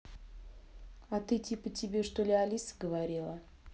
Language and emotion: Russian, neutral